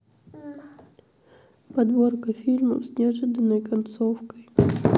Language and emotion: Russian, sad